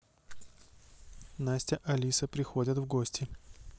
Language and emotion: Russian, neutral